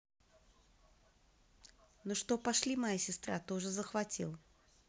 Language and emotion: Russian, neutral